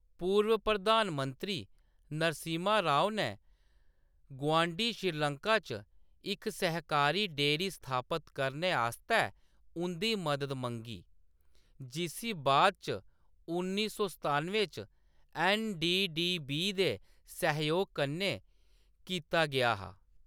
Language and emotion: Dogri, neutral